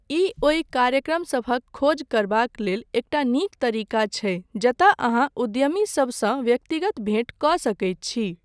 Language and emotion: Maithili, neutral